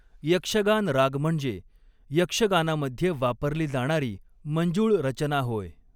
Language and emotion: Marathi, neutral